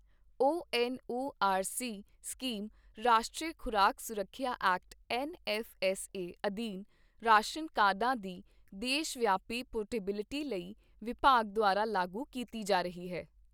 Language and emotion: Punjabi, neutral